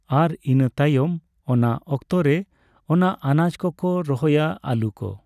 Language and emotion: Santali, neutral